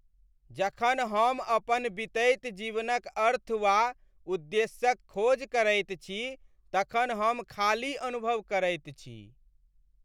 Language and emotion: Maithili, sad